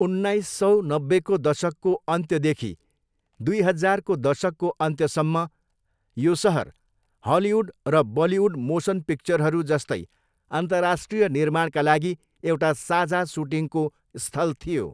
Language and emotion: Nepali, neutral